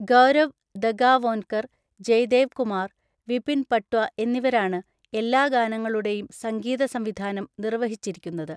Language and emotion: Malayalam, neutral